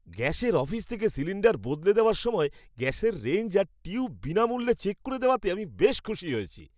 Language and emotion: Bengali, happy